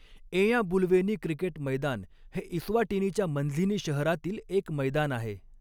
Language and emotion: Marathi, neutral